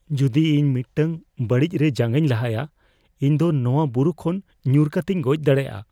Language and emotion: Santali, fearful